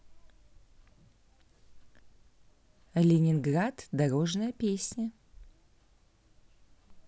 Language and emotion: Russian, neutral